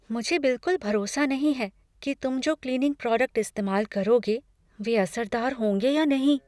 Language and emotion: Hindi, fearful